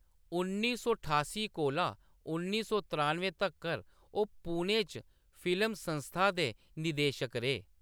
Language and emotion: Dogri, neutral